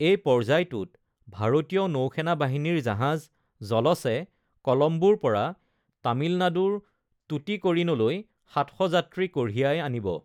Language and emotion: Assamese, neutral